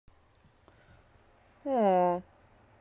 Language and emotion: Russian, sad